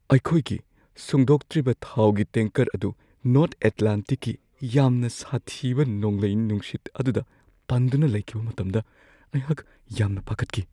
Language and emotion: Manipuri, fearful